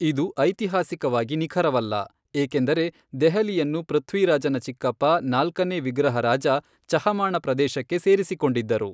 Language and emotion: Kannada, neutral